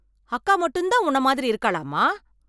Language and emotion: Tamil, angry